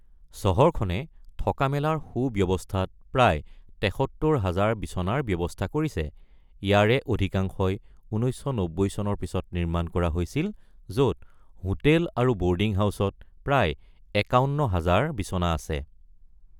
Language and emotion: Assamese, neutral